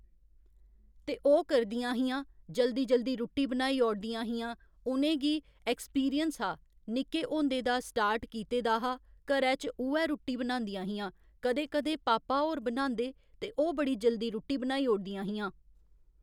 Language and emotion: Dogri, neutral